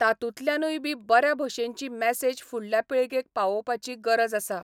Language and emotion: Goan Konkani, neutral